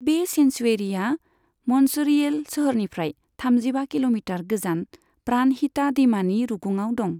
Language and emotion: Bodo, neutral